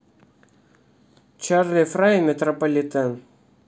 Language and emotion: Russian, neutral